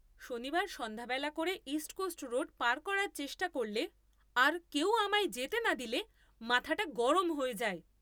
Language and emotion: Bengali, angry